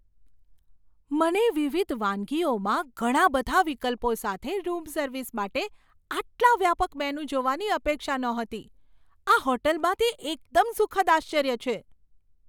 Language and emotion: Gujarati, surprised